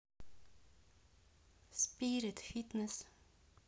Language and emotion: Russian, neutral